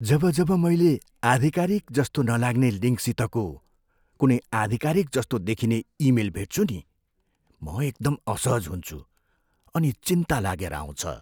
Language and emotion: Nepali, fearful